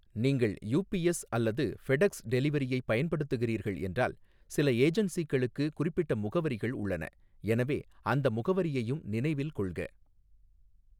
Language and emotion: Tamil, neutral